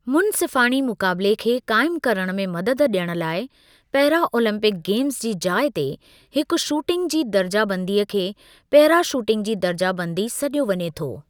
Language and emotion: Sindhi, neutral